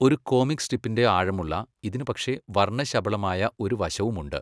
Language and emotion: Malayalam, neutral